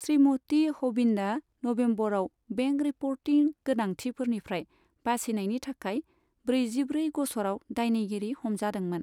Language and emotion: Bodo, neutral